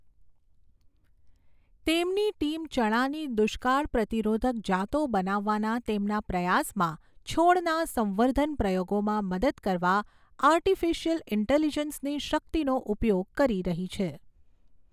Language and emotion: Gujarati, neutral